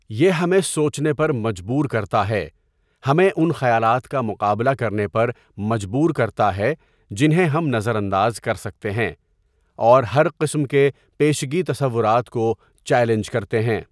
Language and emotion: Urdu, neutral